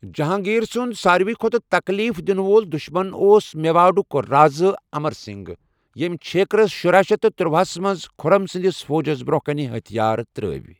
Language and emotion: Kashmiri, neutral